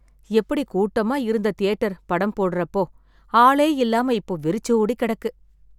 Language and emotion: Tamil, sad